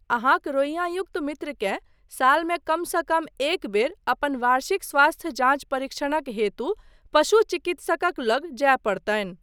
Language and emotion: Maithili, neutral